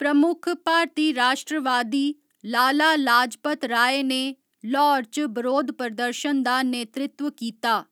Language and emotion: Dogri, neutral